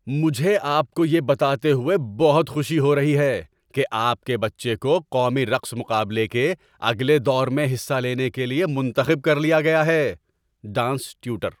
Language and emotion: Urdu, happy